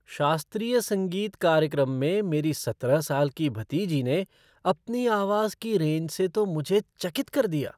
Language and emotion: Hindi, surprised